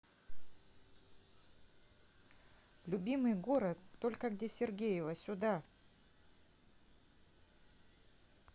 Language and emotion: Russian, neutral